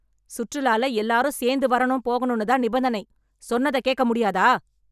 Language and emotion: Tamil, angry